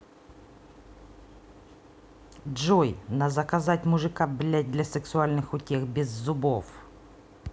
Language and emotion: Russian, angry